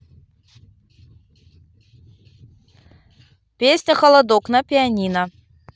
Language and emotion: Russian, positive